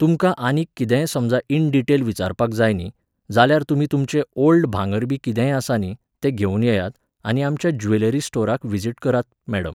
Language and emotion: Goan Konkani, neutral